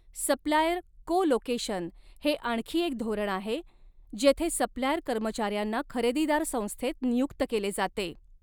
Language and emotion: Marathi, neutral